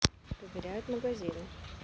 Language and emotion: Russian, neutral